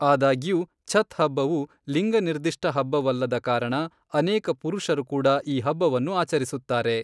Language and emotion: Kannada, neutral